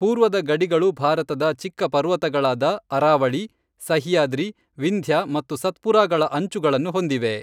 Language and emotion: Kannada, neutral